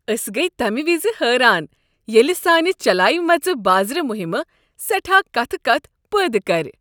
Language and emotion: Kashmiri, happy